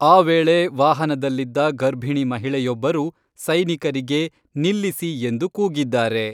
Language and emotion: Kannada, neutral